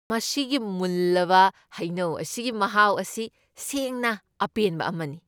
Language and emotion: Manipuri, happy